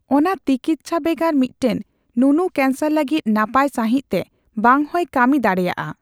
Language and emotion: Santali, neutral